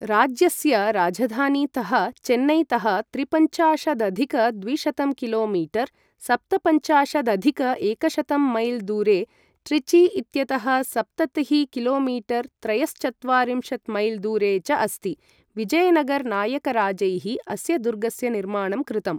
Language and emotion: Sanskrit, neutral